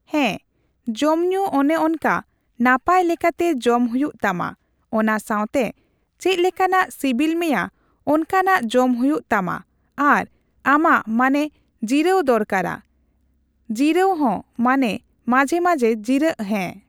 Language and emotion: Santali, neutral